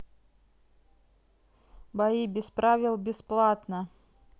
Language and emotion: Russian, neutral